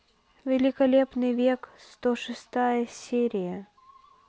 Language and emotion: Russian, neutral